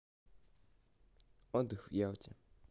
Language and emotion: Russian, neutral